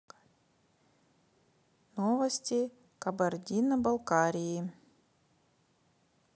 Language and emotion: Russian, neutral